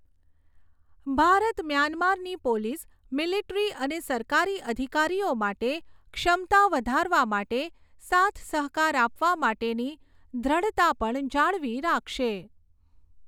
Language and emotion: Gujarati, neutral